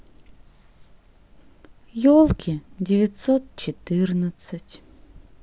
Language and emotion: Russian, sad